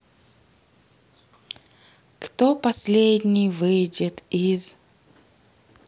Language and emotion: Russian, sad